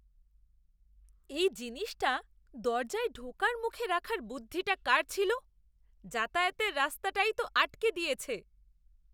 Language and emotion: Bengali, disgusted